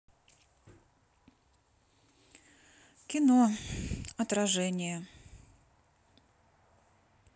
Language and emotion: Russian, sad